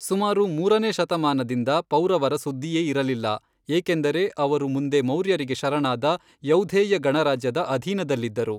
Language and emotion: Kannada, neutral